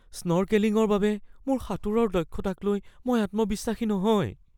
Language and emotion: Assamese, fearful